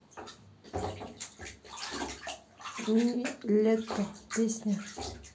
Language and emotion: Russian, neutral